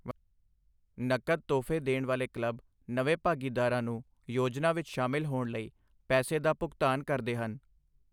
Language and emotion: Punjabi, neutral